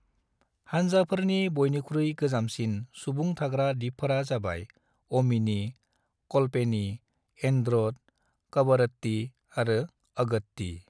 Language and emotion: Bodo, neutral